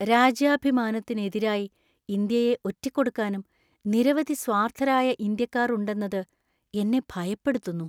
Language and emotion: Malayalam, fearful